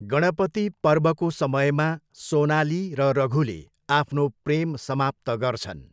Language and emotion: Nepali, neutral